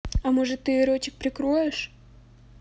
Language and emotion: Russian, neutral